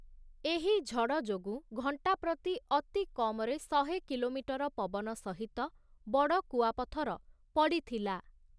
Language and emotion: Odia, neutral